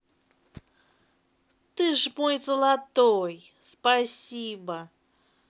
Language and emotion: Russian, positive